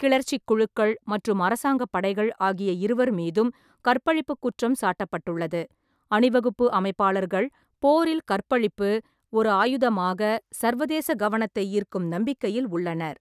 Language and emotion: Tamil, neutral